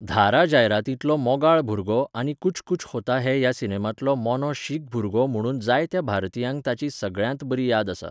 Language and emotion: Goan Konkani, neutral